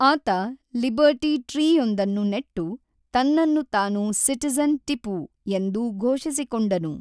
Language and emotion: Kannada, neutral